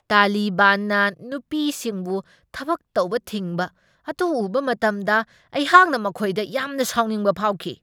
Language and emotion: Manipuri, angry